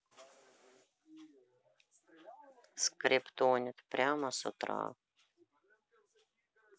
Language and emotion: Russian, neutral